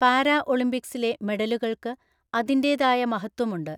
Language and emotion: Malayalam, neutral